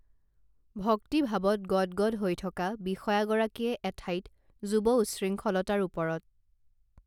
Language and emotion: Assamese, neutral